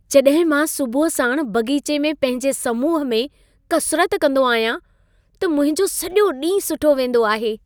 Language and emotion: Sindhi, happy